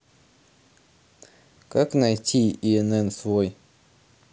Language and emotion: Russian, neutral